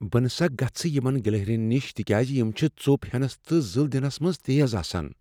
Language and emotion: Kashmiri, fearful